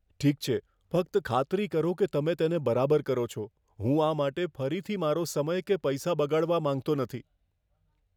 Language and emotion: Gujarati, fearful